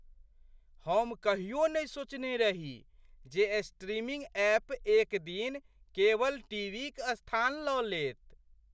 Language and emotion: Maithili, surprised